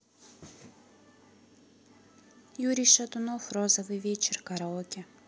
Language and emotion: Russian, neutral